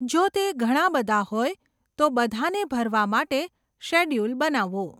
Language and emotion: Gujarati, neutral